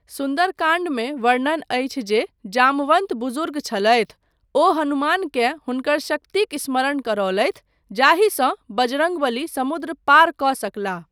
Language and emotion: Maithili, neutral